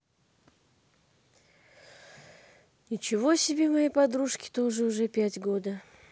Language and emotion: Russian, sad